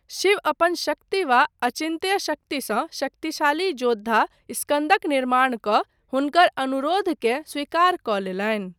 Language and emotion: Maithili, neutral